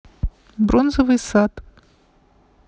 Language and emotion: Russian, neutral